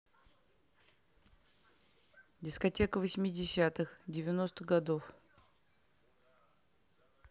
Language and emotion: Russian, neutral